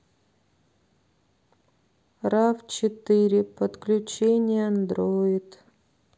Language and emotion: Russian, sad